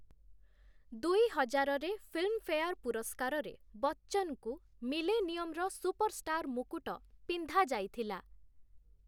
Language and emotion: Odia, neutral